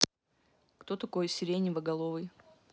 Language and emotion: Russian, neutral